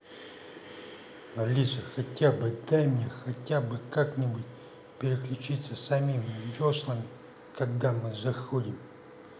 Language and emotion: Russian, angry